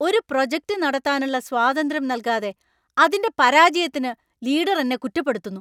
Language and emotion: Malayalam, angry